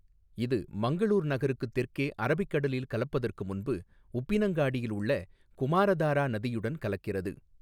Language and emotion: Tamil, neutral